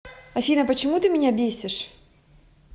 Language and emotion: Russian, angry